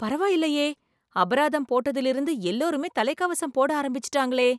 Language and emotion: Tamil, surprised